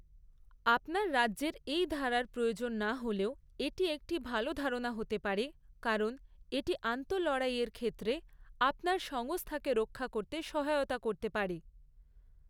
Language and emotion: Bengali, neutral